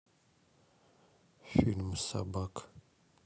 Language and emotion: Russian, sad